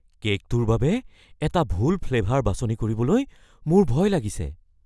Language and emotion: Assamese, fearful